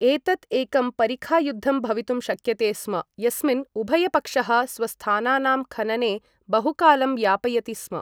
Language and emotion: Sanskrit, neutral